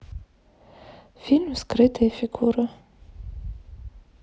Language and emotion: Russian, neutral